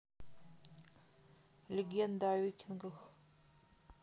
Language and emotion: Russian, neutral